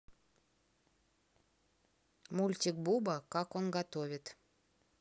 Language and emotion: Russian, neutral